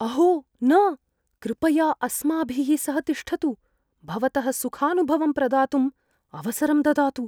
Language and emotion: Sanskrit, fearful